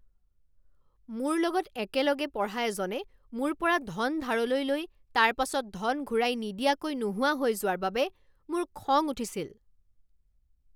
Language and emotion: Assamese, angry